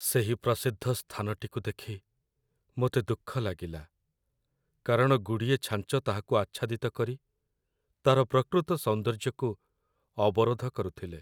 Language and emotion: Odia, sad